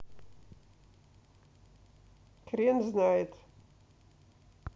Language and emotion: Russian, neutral